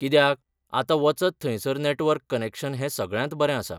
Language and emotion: Goan Konkani, neutral